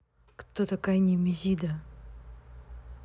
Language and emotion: Russian, neutral